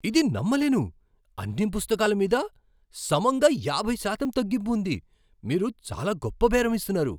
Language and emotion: Telugu, surprised